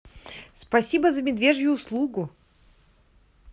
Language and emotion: Russian, positive